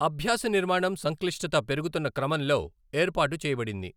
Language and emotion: Telugu, neutral